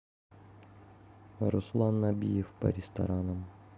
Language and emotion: Russian, neutral